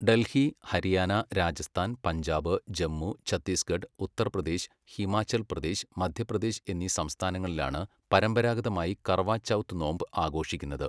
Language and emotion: Malayalam, neutral